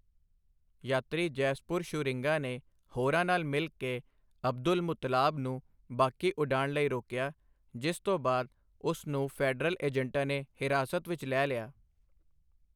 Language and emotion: Punjabi, neutral